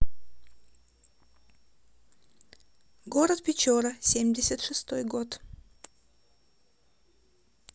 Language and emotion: Russian, neutral